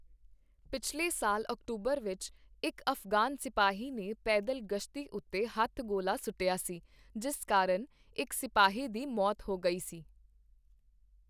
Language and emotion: Punjabi, neutral